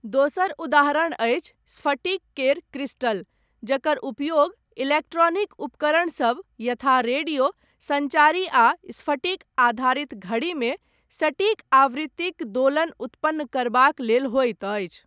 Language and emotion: Maithili, neutral